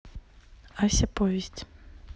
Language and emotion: Russian, neutral